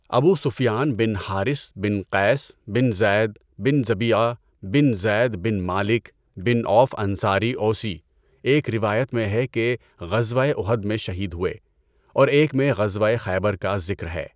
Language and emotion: Urdu, neutral